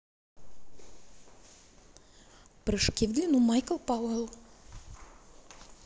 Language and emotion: Russian, neutral